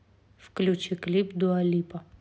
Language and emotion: Russian, neutral